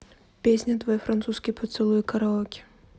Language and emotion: Russian, neutral